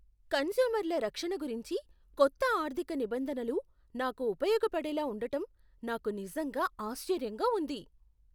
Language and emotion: Telugu, surprised